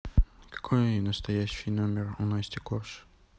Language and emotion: Russian, neutral